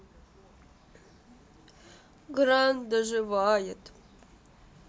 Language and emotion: Russian, sad